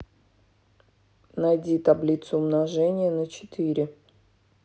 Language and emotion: Russian, neutral